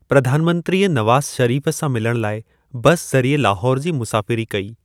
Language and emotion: Sindhi, neutral